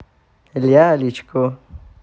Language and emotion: Russian, positive